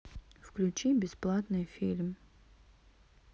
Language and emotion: Russian, sad